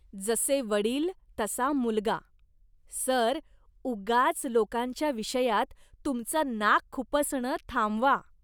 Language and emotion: Marathi, disgusted